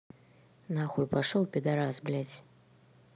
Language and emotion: Russian, neutral